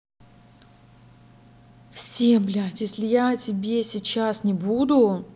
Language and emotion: Russian, angry